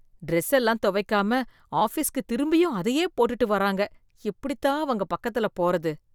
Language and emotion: Tamil, disgusted